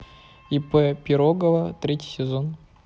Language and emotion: Russian, neutral